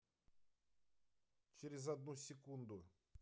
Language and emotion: Russian, neutral